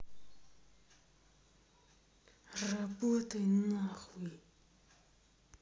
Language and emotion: Russian, angry